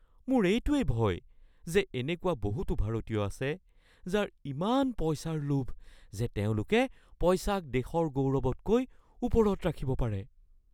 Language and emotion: Assamese, fearful